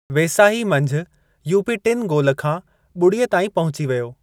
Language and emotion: Sindhi, neutral